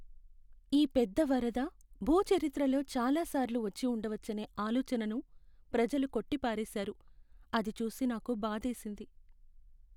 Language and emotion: Telugu, sad